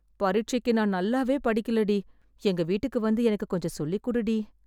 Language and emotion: Tamil, sad